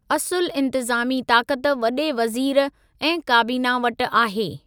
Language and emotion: Sindhi, neutral